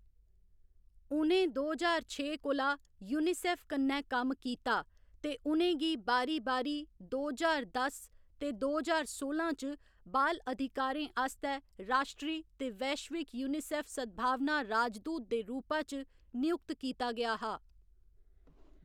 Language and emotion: Dogri, neutral